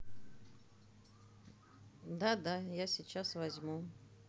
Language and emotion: Russian, neutral